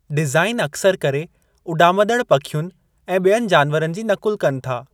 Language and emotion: Sindhi, neutral